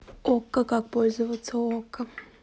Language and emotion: Russian, neutral